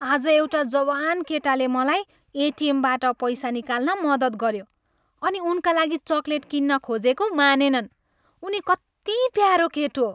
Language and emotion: Nepali, happy